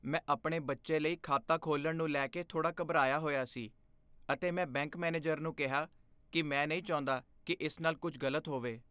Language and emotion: Punjabi, fearful